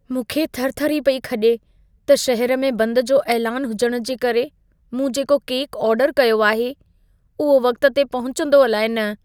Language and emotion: Sindhi, fearful